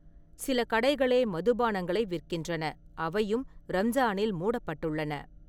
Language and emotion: Tamil, neutral